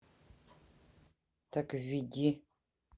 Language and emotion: Russian, neutral